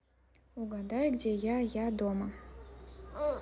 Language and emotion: Russian, neutral